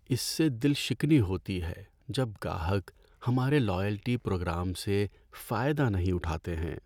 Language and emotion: Urdu, sad